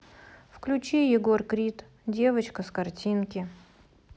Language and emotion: Russian, neutral